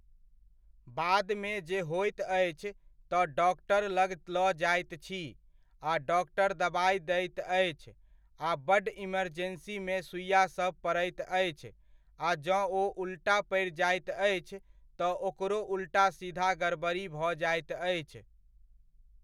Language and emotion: Maithili, neutral